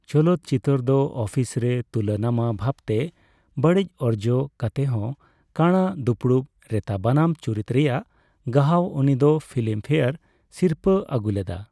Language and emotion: Santali, neutral